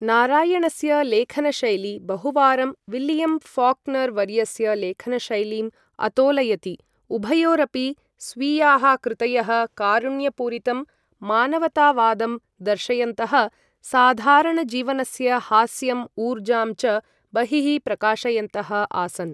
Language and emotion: Sanskrit, neutral